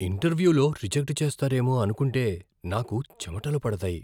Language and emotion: Telugu, fearful